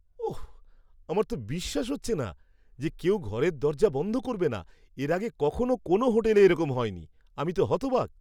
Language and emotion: Bengali, surprised